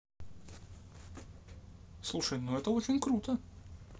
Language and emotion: Russian, positive